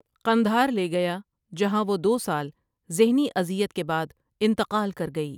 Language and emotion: Urdu, neutral